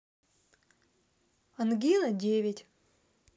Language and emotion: Russian, neutral